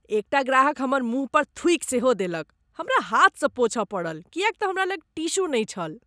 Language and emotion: Maithili, disgusted